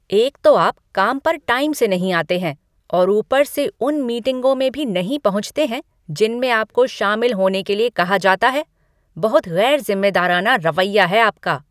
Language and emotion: Hindi, angry